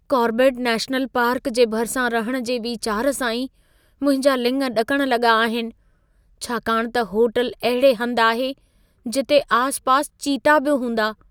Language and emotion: Sindhi, fearful